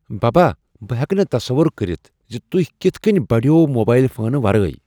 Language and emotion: Kashmiri, surprised